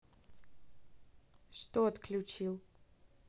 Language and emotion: Russian, neutral